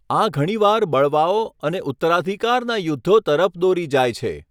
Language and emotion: Gujarati, neutral